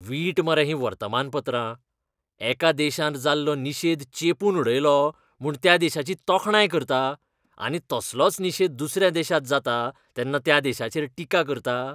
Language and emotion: Goan Konkani, disgusted